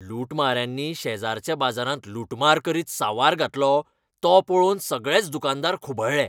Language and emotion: Goan Konkani, angry